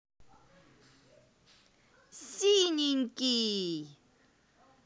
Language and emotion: Russian, positive